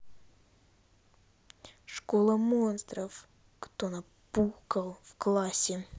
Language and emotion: Russian, angry